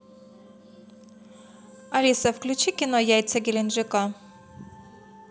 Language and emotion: Russian, neutral